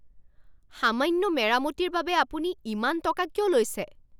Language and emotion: Assamese, angry